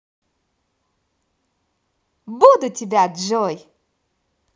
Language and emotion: Russian, positive